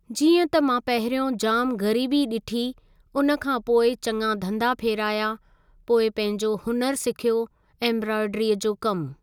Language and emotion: Sindhi, neutral